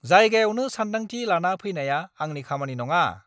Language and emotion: Bodo, angry